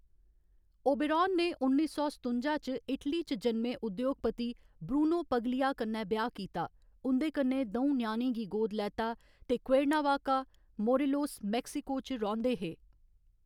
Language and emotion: Dogri, neutral